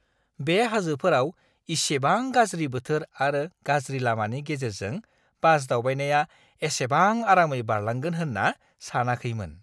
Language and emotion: Bodo, surprised